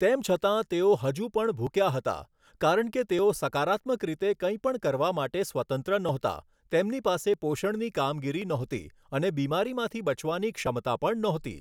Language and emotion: Gujarati, neutral